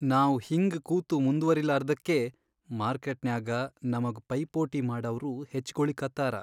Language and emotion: Kannada, sad